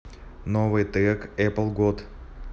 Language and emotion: Russian, neutral